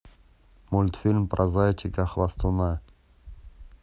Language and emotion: Russian, neutral